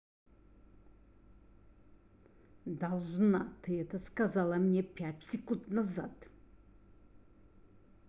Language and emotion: Russian, angry